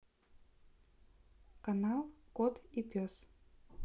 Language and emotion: Russian, neutral